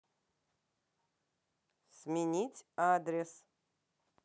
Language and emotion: Russian, neutral